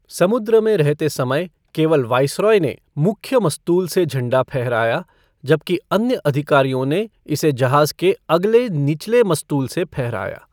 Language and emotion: Hindi, neutral